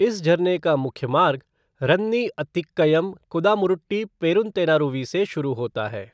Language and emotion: Hindi, neutral